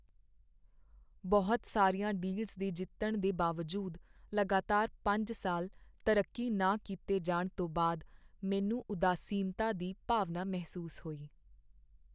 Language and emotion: Punjabi, sad